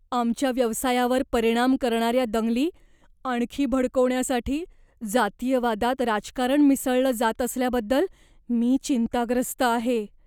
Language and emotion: Marathi, fearful